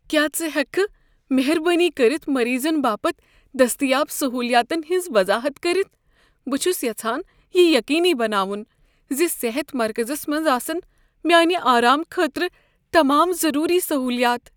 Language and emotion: Kashmiri, fearful